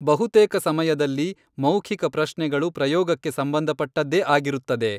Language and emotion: Kannada, neutral